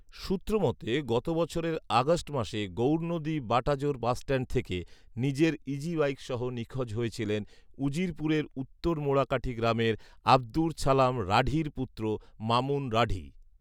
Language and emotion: Bengali, neutral